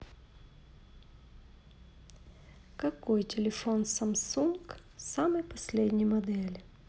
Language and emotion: Russian, neutral